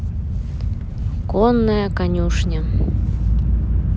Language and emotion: Russian, neutral